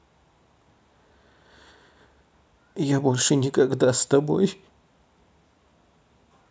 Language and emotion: Russian, sad